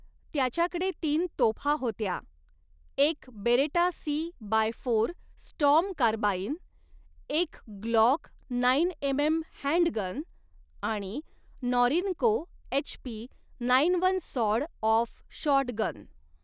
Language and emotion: Marathi, neutral